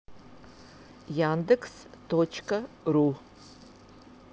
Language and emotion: Russian, neutral